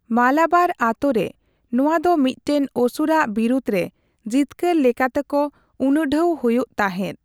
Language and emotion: Santali, neutral